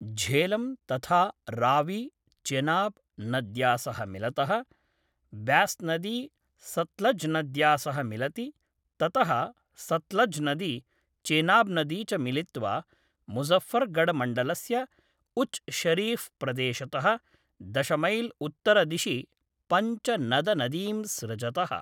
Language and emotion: Sanskrit, neutral